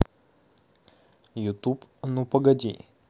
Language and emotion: Russian, neutral